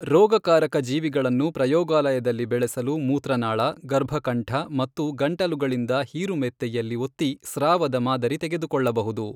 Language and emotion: Kannada, neutral